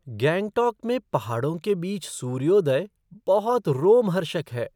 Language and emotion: Hindi, surprised